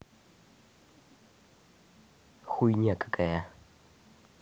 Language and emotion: Russian, angry